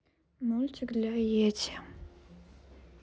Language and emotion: Russian, neutral